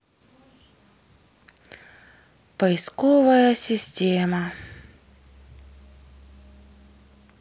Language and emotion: Russian, sad